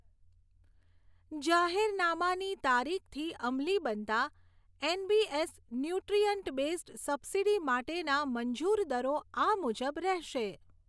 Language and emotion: Gujarati, neutral